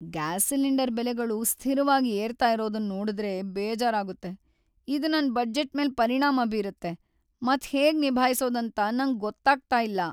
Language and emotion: Kannada, sad